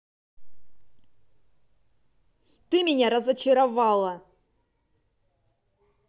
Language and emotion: Russian, angry